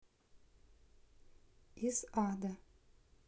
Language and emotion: Russian, neutral